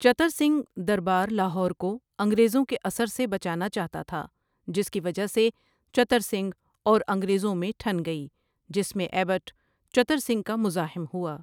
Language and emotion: Urdu, neutral